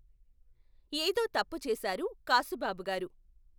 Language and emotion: Telugu, neutral